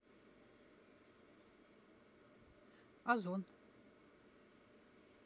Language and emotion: Russian, neutral